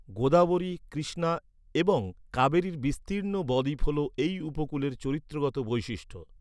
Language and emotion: Bengali, neutral